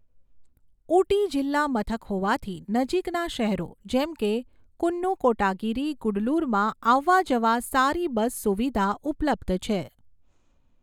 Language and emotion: Gujarati, neutral